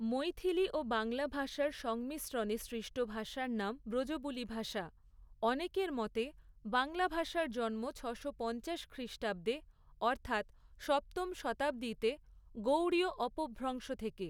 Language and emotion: Bengali, neutral